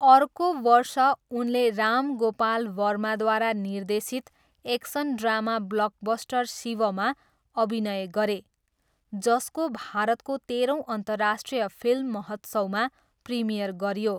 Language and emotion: Nepali, neutral